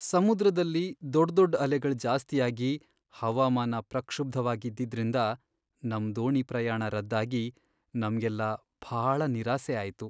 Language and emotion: Kannada, sad